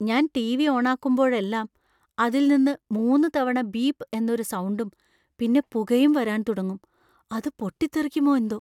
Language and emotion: Malayalam, fearful